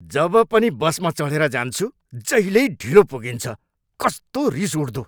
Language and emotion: Nepali, angry